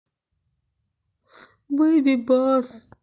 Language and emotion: Russian, sad